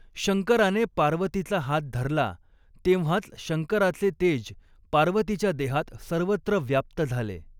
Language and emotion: Marathi, neutral